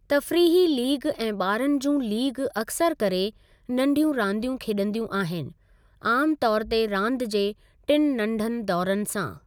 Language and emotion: Sindhi, neutral